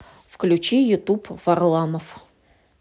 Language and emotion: Russian, neutral